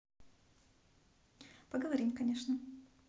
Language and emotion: Russian, positive